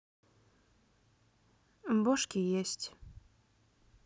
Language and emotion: Russian, neutral